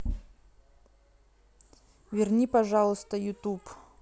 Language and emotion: Russian, neutral